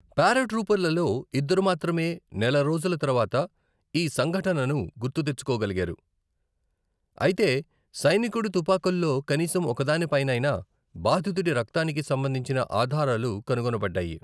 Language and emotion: Telugu, neutral